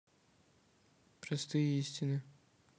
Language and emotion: Russian, neutral